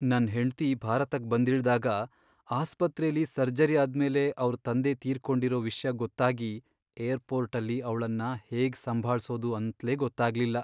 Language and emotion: Kannada, sad